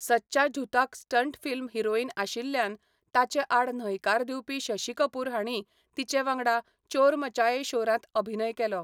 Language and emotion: Goan Konkani, neutral